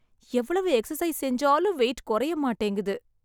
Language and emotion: Tamil, sad